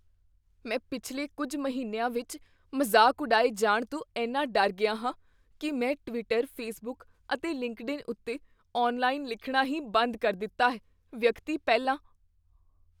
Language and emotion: Punjabi, fearful